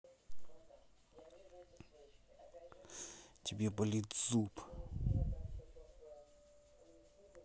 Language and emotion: Russian, angry